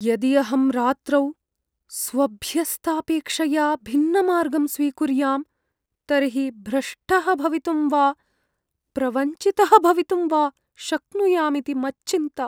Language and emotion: Sanskrit, fearful